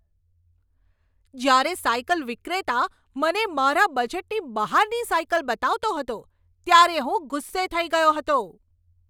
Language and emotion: Gujarati, angry